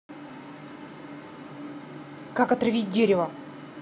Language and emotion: Russian, angry